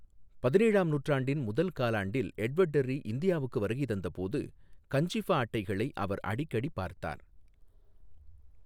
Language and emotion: Tamil, neutral